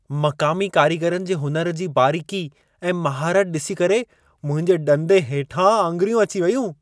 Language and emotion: Sindhi, surprised